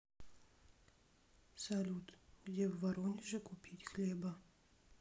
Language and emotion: Russian, sad